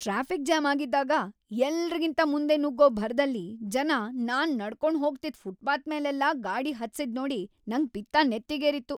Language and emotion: Kannada, angry